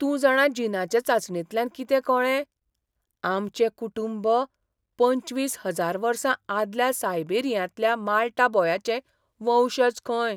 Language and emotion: Goan Konkani, surprised